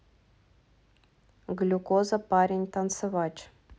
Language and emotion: Russian, neutral